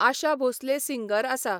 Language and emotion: Goan Konkani, neutral